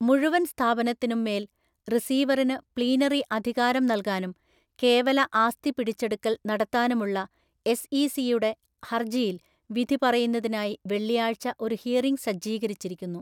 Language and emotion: Malayalam, neutral